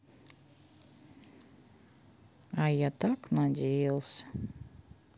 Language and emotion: Russian, sad